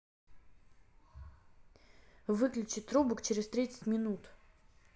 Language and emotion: Russian, neutral